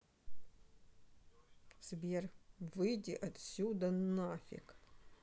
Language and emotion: Russian, angry